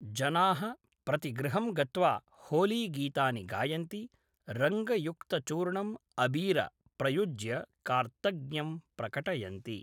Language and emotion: Sanskrit, neutral